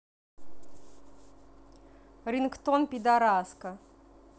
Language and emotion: Russian, neutral